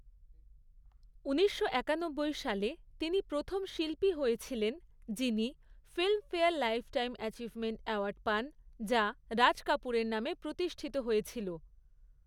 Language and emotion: Bengali, neutral